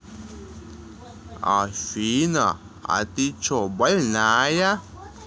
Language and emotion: Russian, neutral